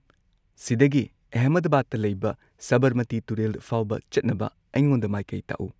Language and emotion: Manipuri, neutral